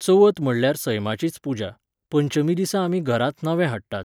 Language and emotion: Goan Konkani, neutral